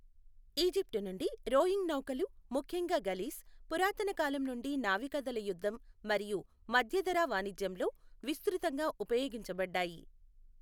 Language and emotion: Telugu, neutral